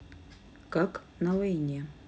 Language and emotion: Russian, neutral